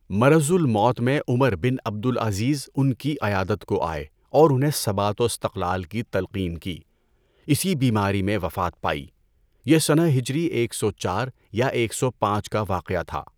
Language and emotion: Urdu, neutral